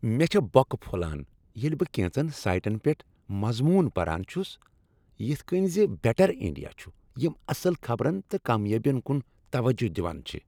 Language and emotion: Kashmiri, happy